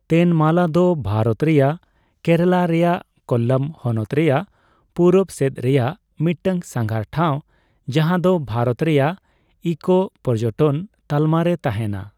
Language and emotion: Santali, neutral